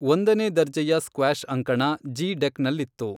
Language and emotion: Kannada, neutral